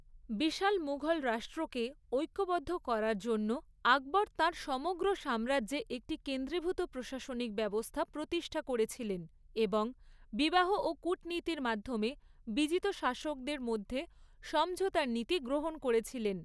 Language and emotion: Bengali, neutral